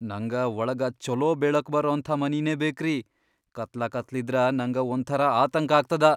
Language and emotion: Kannada, fearful